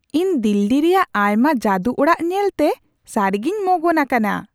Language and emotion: Santali, surprised